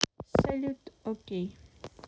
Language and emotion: Russian, neutral